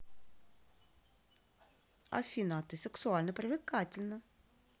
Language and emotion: Russian, positive